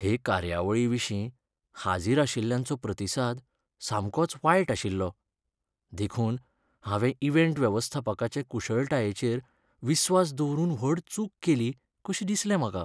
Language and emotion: Goan Konkani, sad